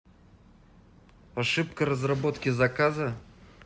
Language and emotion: Russian, neutral